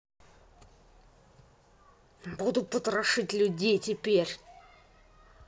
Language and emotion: Russian, angry